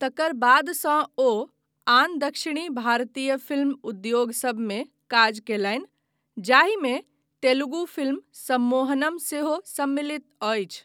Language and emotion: Maithili, neutral